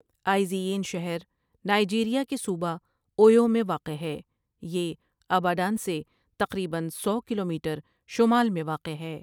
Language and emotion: Urdu, neutral